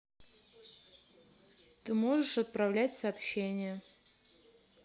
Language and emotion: Russian, neutral